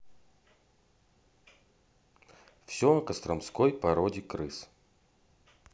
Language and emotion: Russian, neutral